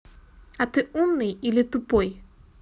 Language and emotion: Russian, neutral